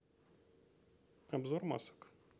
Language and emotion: Russian, neutral